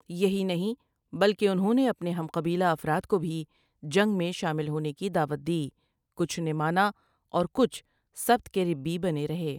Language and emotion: Urdu, neutral